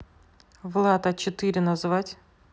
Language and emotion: Russian, neutral